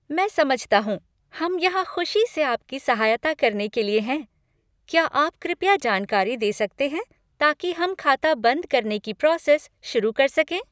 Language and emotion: Hindi, happy